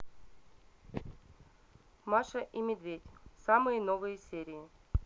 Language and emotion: Russian, neutral